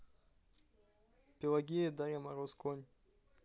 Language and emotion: Russian, neutral